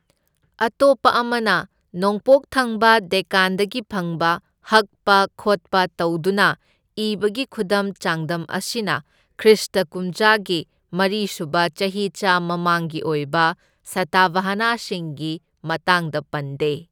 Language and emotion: Manipuri, neutral